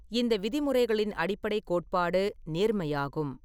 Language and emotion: Tamil, neutral